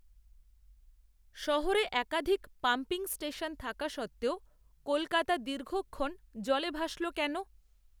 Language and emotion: Bengali, neutral